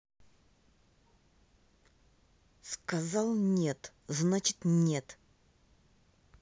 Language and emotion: Russian, angry